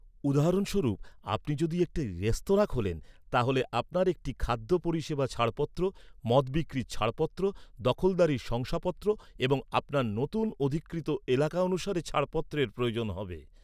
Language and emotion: Bengali, neutral